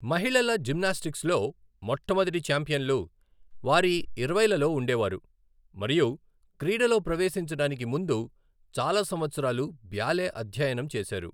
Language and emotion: Telugu, neutral